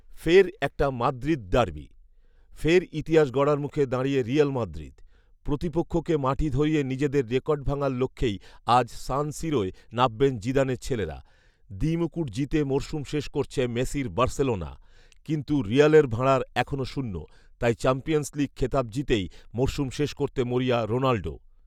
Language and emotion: Bengali, neutral